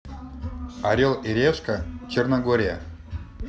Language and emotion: Russian, neutral